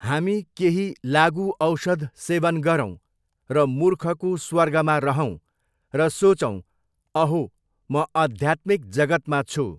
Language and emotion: Nepali, neutral